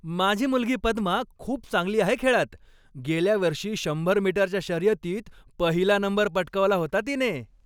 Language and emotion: Marathi, happy